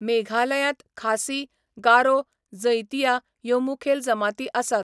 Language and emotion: Goan Konkani, neutral